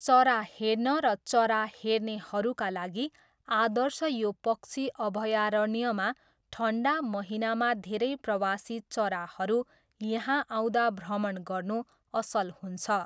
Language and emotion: Nepali, neutral